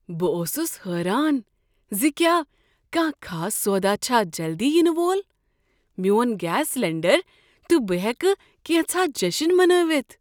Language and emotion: Kashmiri, surprised